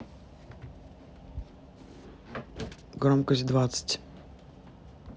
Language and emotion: Russian, neutral